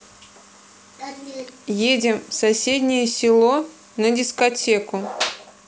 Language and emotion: Russian, neutral